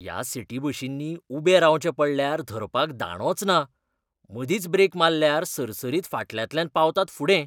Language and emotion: Goan Konkani, disgusted